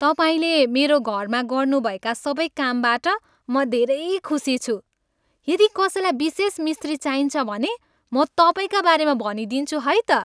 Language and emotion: Nepali, happy